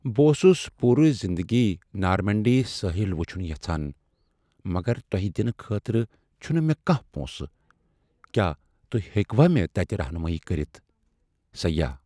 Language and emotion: Kashmiri, sad